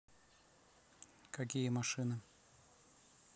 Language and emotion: Russian, neutral